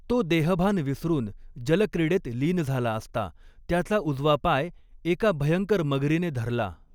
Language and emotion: Marathi, neutral